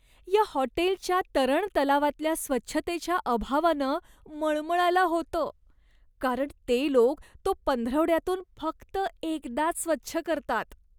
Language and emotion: Marathi, disgusted